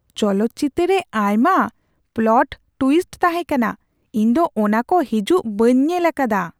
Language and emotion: Santali, surprised